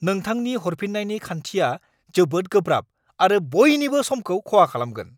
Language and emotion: Bodo, angry